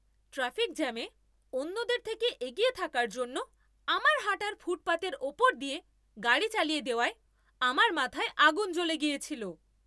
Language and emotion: Bengali, angry